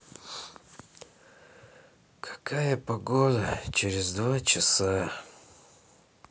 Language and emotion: Russian, sad